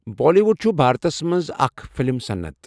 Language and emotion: Kashmiri, neutral